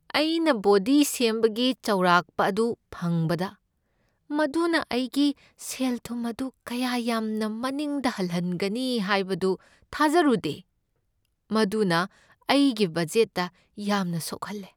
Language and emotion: Manipuri, sad